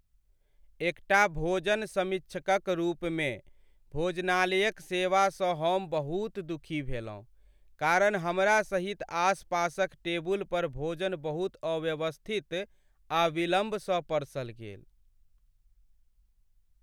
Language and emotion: Maithili, sad